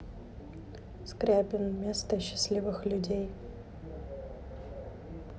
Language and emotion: Russian, neutral